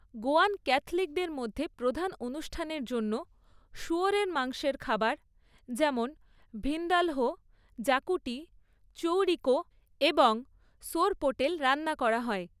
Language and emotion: Bengali, neutral